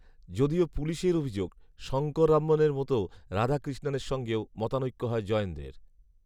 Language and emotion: Bengali, neutral